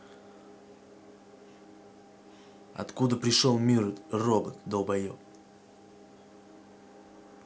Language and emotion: Russian, angry